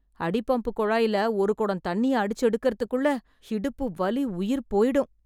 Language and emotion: Tamil, sad